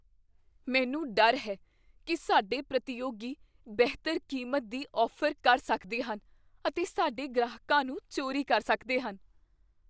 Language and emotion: Punjabi, fearful